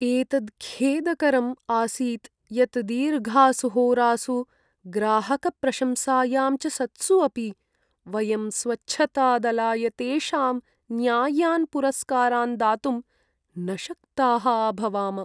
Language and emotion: Sanskrit, sad